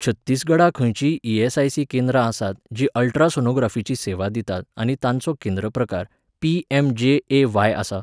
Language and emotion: Goan Konkani, neutral